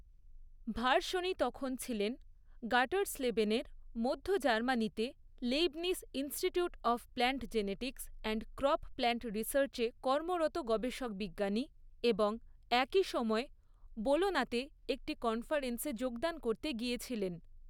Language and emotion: Bengali, neutral